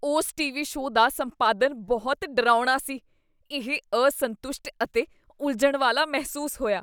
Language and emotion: Punjabi, disgusted